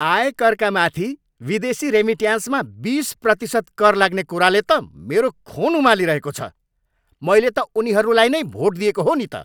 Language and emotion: Nepali, angry